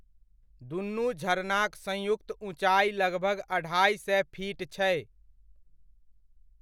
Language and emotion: Maithili, neutral